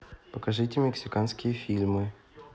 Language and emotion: Russian, neutral